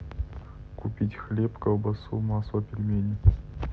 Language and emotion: Russian, neutral